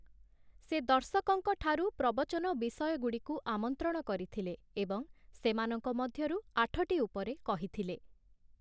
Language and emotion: Odia, neutral